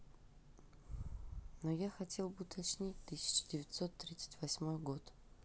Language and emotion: Russian, sad